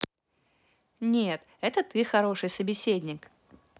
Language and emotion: Russian, positive